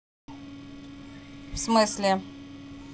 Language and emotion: Russian, angry